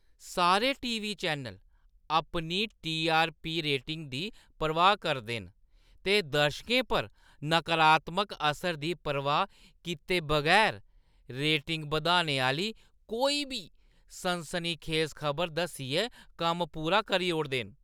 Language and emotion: Dogri, disgusted